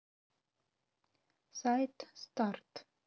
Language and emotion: Russian, neutral